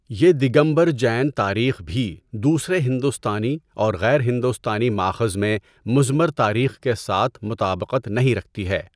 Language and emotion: Urdu, neutral